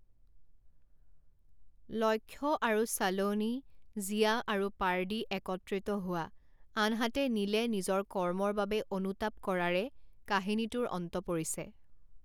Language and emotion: Assamese, neutral